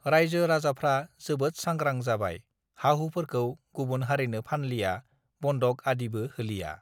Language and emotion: Bodo, neutral